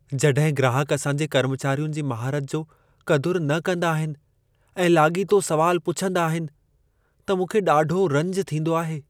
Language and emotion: Sindhi, sad